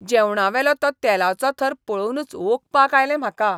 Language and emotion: Goan Konkani, disgusted